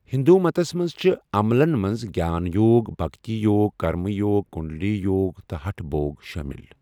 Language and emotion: Kashmiri, neutral